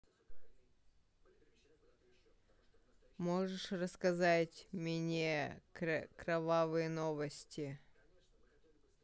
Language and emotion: Russian, neutral